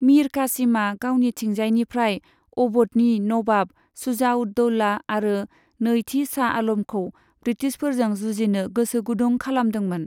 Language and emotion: Bodo, neutral